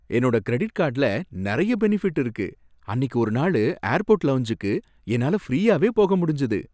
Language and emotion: Tamil, happy